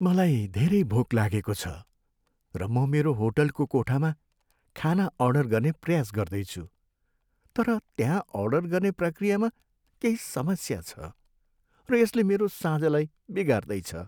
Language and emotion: Nepali, sad